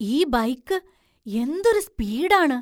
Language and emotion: Malayalam, surprised